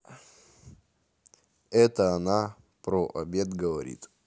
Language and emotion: Russian, neutral